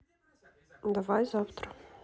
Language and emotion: Russian, neutral